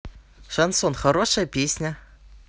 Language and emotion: Russian, neutral